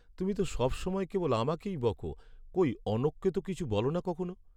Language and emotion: Bengali, sad